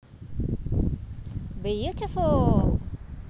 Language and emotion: Russian, positive